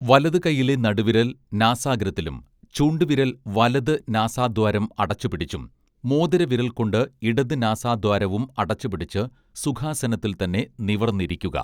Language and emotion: Malayalam, neutral